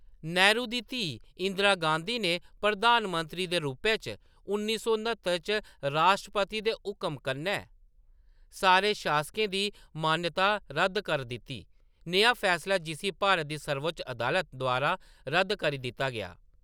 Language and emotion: Dogri, neutral